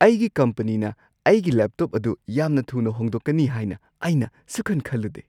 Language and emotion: Manipuri, surprised